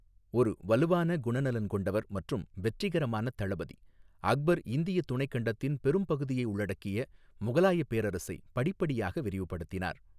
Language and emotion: Tamil, neutral